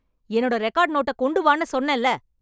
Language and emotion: Tamil, angry